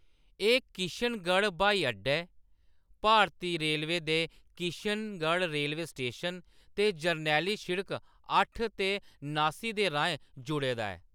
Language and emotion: Dogri, neutral